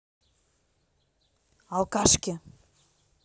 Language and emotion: Russian, angry